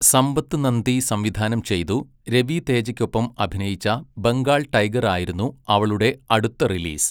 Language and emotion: Malayalam, neutral